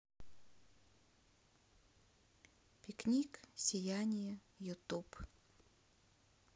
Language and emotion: Russian, neutral